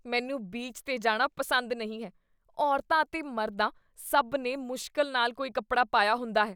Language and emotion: Punjabi, disgusted